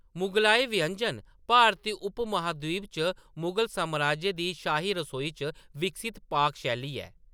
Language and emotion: Dogri, neutral